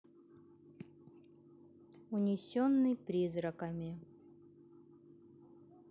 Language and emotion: Russian, neutral